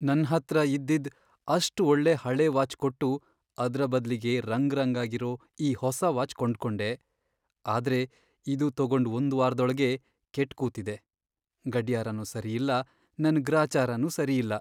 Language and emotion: Kannada, sad